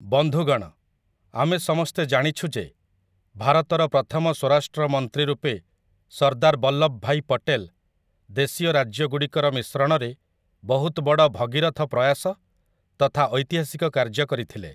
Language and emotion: Odia, neutral